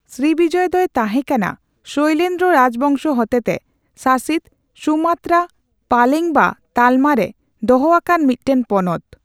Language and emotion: Santali, neutral